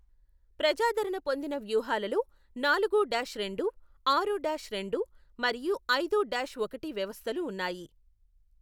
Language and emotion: Telugu, neutral